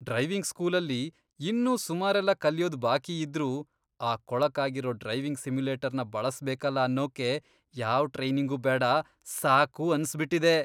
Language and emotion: Kannada, disgusted